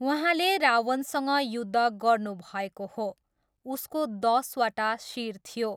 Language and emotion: Nepali, neutral